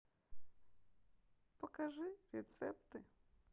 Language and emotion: Russian, sad